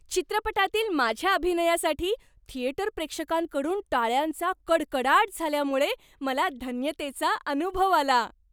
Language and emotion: Marathi, happy